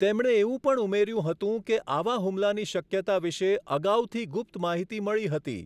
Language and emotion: Gujarati, neutral